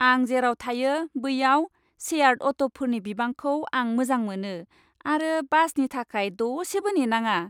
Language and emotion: Bodo, happy